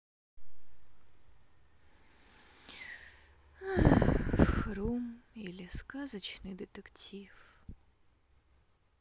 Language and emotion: Russian, sad